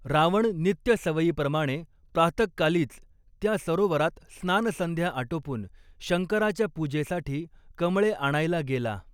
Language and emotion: Marathi, neutral